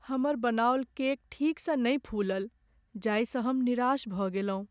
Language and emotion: Maithili, sad